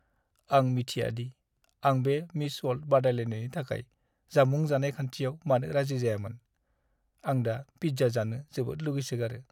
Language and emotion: Bodo, sad